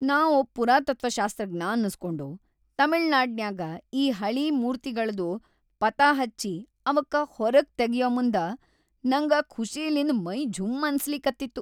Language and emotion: Kannada, happy